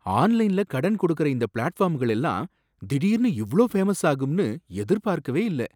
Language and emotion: Tamil, surprised